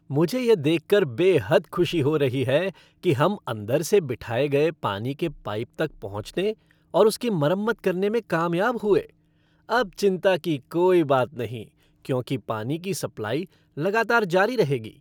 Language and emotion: Hindi, happy